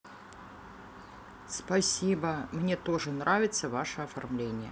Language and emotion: Russian, neutral